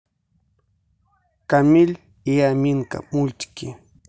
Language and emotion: Russian, neutral